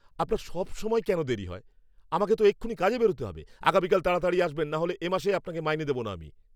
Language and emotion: Bengali, angry